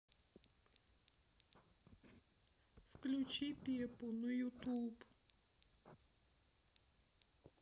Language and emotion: Russian, sad